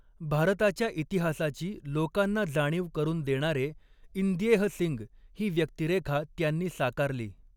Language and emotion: Marathi, neutral